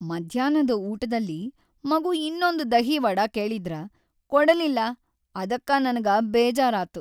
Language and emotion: Kannada, sad